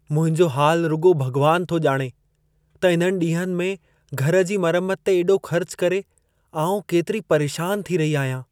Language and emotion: Sindhi, sad